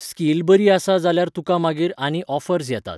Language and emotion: Goan Konkani, neutral